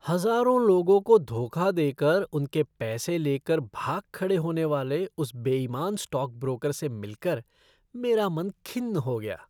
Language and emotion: Hindi, disgusted